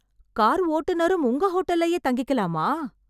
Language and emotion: Tamil, surprised